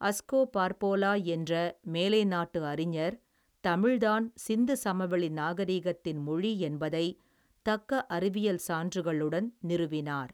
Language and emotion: Tamil, neutral